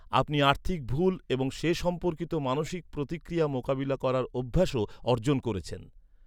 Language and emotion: Bengali, neutral